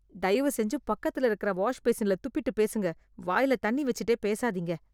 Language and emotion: Tamil, disgusted